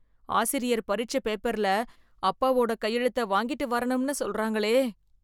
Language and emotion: Tamil, fearful